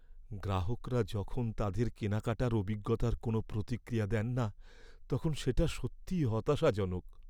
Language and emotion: Bengali, sad